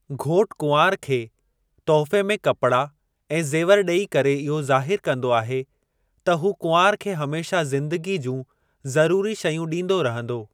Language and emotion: Sindhi, neutral